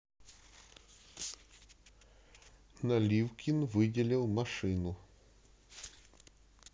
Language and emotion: Russian, neutral